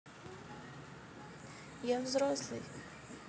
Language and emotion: Russian, neutral